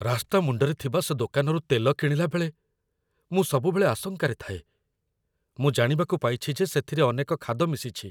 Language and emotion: Odia, fearful